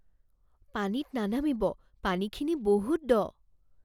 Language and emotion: Assamese, fearful